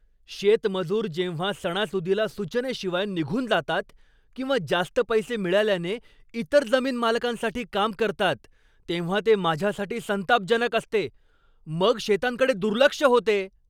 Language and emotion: Marathi, angry